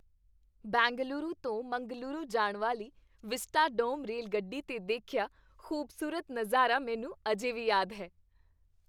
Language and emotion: Punjabi, happy